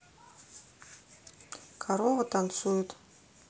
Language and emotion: Russian, neutral